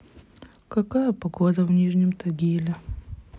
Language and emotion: Russian, sad